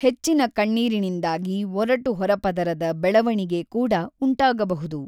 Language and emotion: Kannada, neutral